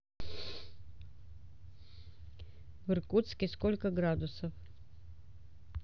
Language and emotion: Russian, neutral